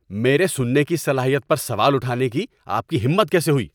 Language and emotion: Urdu, angry